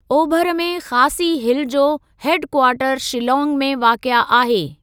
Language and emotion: Sindhi, neutral